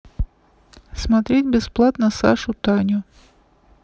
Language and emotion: Russian, neutral